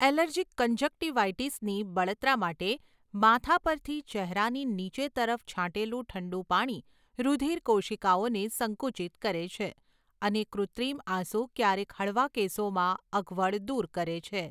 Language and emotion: Gujarati, neutral